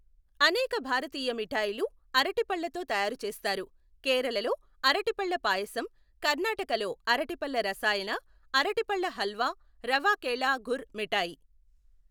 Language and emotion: Telugu, neutral